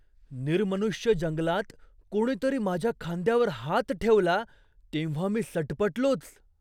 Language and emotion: Marathi, surprised